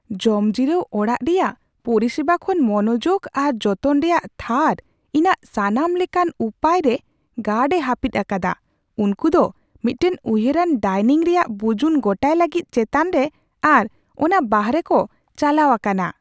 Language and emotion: Santali, surprised